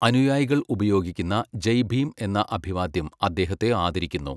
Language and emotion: Malayalam, neutral